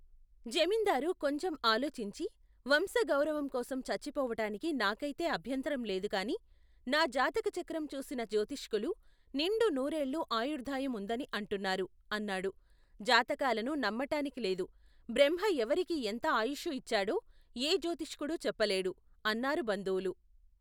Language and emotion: Telugu, neutral